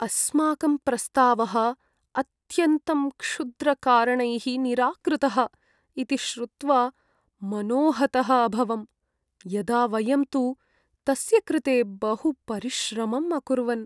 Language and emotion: Sanskrit, sad